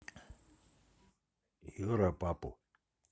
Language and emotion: Russian, neutral